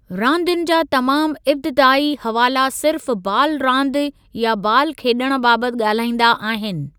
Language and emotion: Sindhi, neutral